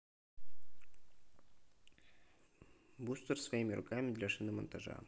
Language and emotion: Russian, neutral